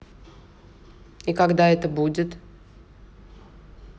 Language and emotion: Russian, neutral